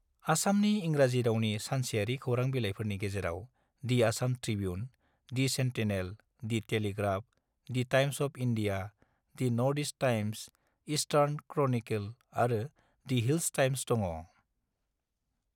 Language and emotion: Bodo, neutral